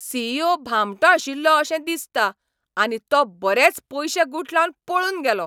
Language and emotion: Goan Konkani, angry